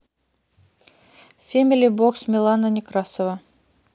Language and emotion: Russian, neutral